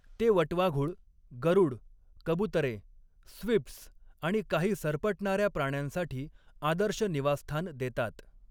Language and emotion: Marathi, neutral